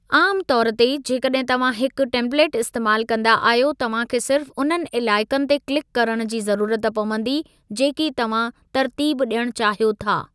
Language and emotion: Sindhi, neutral